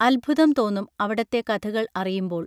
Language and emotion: Malayalam, neutral